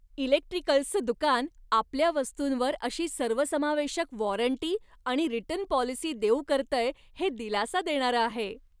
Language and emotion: Marathi, happy